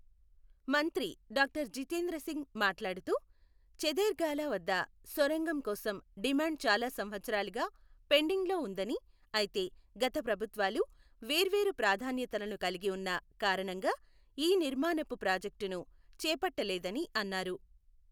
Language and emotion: Telugu, neutral